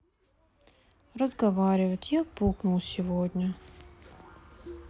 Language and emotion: Russian, sad